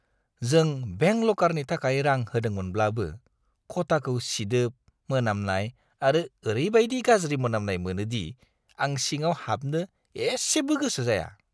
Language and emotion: Bodo, disgusted